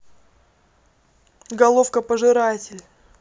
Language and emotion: Russian, neutral